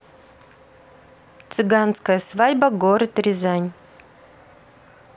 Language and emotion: Russian, neutral